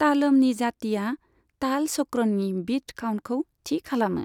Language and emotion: Bodo, neutral